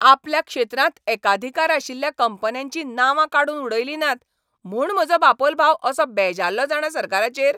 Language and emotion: Goan Konkani, angry